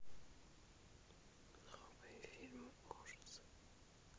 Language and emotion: Russian, neutral